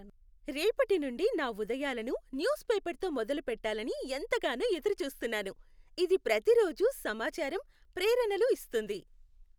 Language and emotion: Telugu, happy